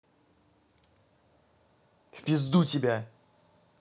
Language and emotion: Russian, angry